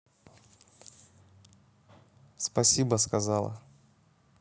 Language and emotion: Russian, neutral